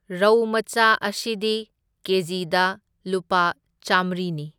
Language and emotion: Manipuri, neutral